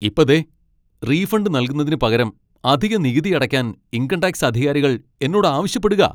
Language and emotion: Malayalam, angry